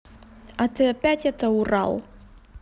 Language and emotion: Russian, neutral